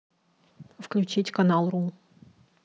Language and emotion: Russian, neutral